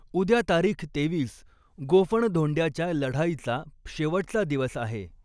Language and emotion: Marathi, neutral